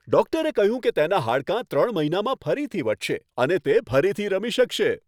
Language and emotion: Gujarati, happy